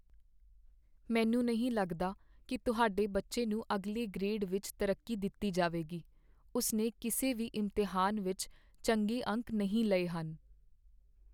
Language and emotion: Punjabi, sad